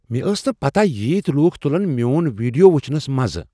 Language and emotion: Kashmiri, surprised